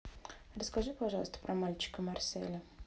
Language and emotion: Russian, neutral